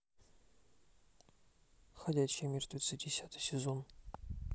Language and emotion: Russian, neutral